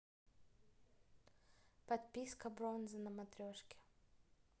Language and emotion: Russian, neutral